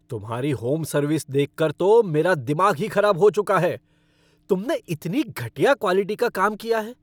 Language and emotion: Hindi, angry